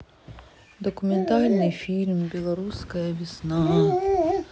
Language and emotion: Russian, sad